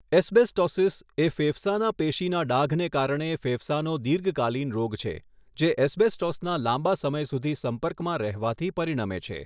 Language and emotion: Gujarati, neutral